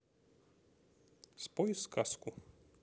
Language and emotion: Russian, neutral